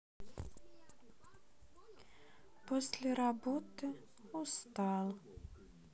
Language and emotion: Russian, sad